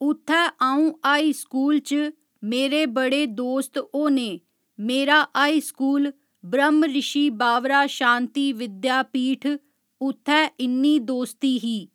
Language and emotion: Dogri, neutral